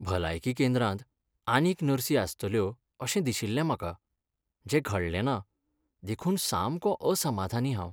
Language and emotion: Goan Konkani, sad